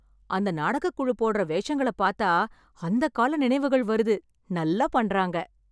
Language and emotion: Tamil, happy